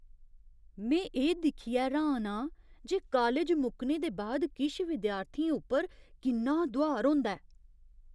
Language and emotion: Dogri, surprised